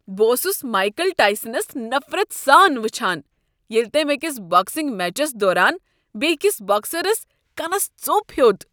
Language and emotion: Kashmiri, disgusted